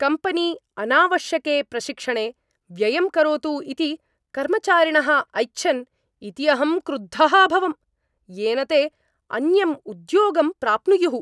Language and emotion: Sanskrit, angry